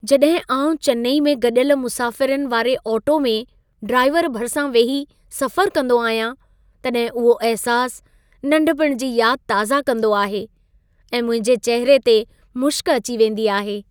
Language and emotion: Sindhi, happy